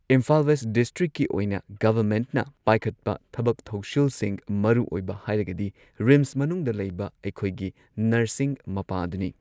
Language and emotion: Manipuri, neutral